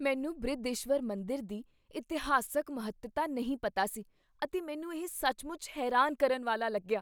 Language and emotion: Punjabi, surprised